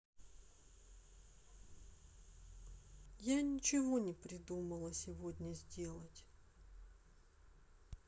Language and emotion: Russian, sad